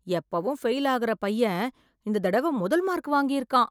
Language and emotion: Tamil, surprised